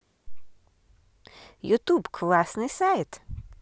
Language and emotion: Russian, positive